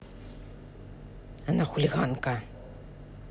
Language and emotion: Russian, angry